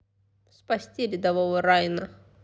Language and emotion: Russian, positive